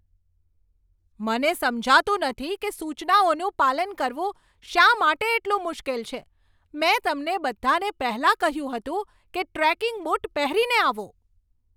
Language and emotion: Gujarati, angry